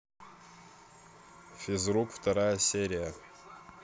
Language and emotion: Russian, neutral